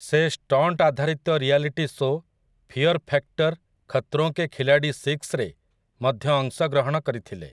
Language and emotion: Odia, neutral